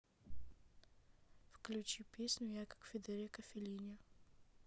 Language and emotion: Russian, neutral